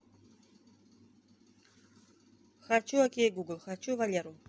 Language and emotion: Russian, neutral